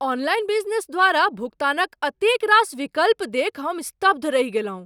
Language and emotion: Maithili, surprised